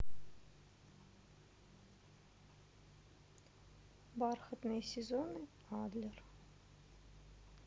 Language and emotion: Russian, sad